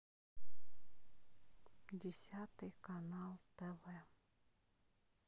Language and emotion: Russian, neutral